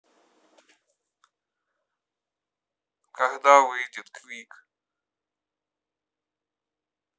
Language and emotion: Russian, neutral